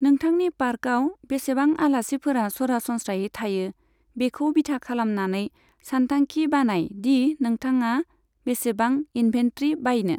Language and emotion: Bodo, neutral